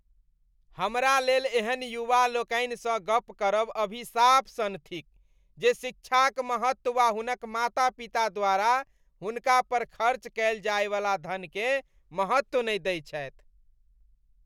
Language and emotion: Maithili, disgusted